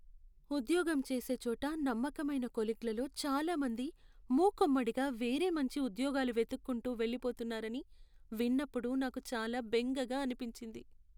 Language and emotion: Telugu, sad